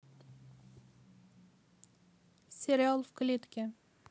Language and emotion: Russian, neutral